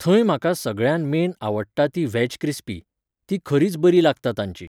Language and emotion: Goan Konkani, neutral